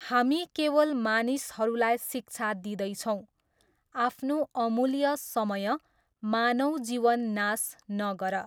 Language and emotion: Nepali, neutral